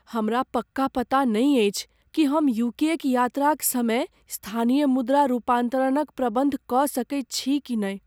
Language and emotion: Maithili, fearful